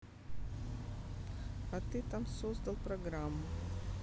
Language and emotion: Russian, neutral